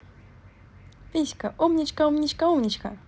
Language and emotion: Russian, positive